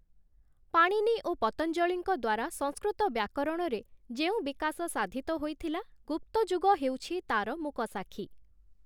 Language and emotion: Odia, neutral